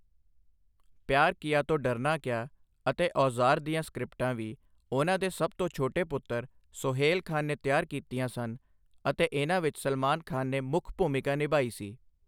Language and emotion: Punjabi, neutral